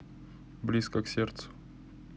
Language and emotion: Russian, neutral